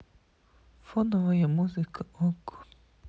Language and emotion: Russian, sad